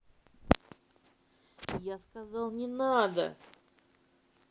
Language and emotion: Russian, angry